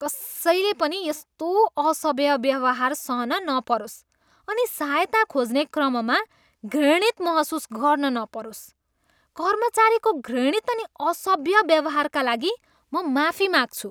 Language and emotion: Nepali, disgusted